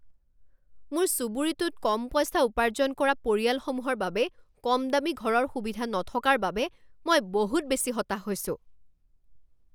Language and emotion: Assamese, angry